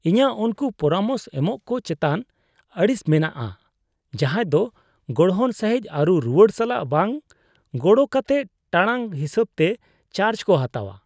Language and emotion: Santali, disgusted